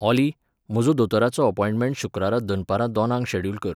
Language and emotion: Goan Konkani, neutral